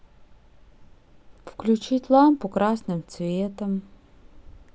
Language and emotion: Russian, sad